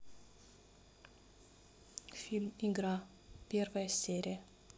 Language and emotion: Russian, neutral